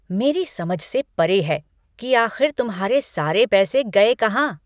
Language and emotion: Hindi, angry